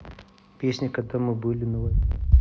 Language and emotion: Russian, neutral